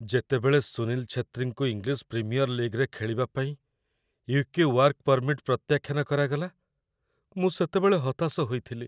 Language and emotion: Odia, sad